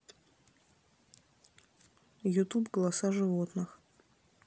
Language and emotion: Russian, neutral